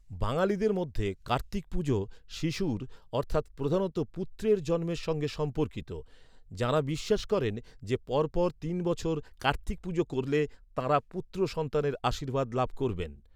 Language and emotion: Bengali, neutral